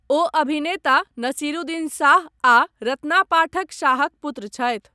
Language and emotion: Maithili, neutral